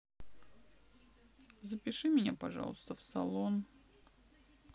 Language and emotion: Russian, sad